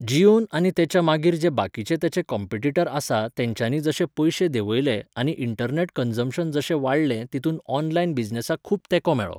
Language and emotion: Goan Konkani, neutral